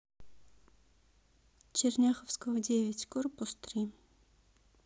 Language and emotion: Russian, sad